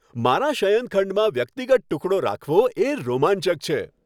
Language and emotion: Gujarati, happy